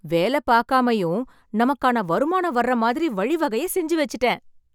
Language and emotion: Tamil, happy